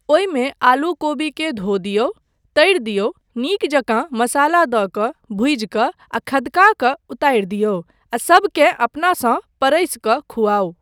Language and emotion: Maithili, neutral